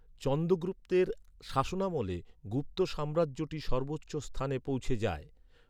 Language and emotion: Bengali, neutral